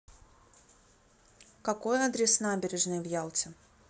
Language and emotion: Russian, neutral